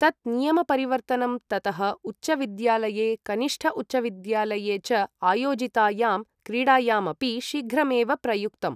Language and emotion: Sanskrit, neutral